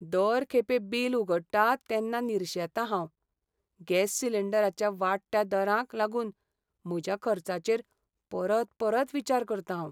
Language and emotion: Goan Konkani, sad